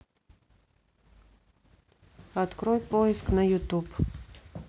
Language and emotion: Russian, neutral